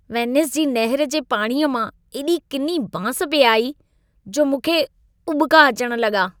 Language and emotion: Sindhi, disgusted